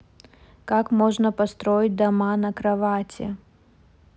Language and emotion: Russian, neutral